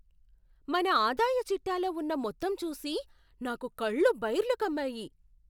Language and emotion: Telugu, surprised